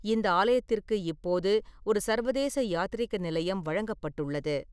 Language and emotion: Tamil, neutral